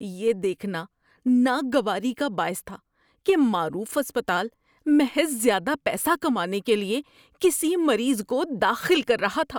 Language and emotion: Urdu, disgusted